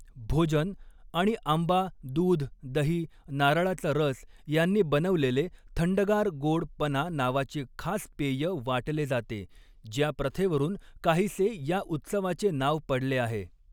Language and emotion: Marathi, neutral